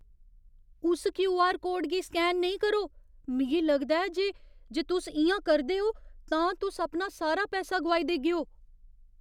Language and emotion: Dogri, fearful